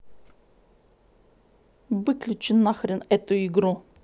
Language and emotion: Russian, angry